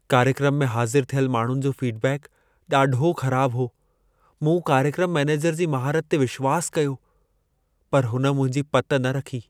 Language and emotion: Sindhi, sad